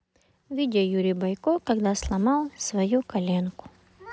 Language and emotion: Russian, neutral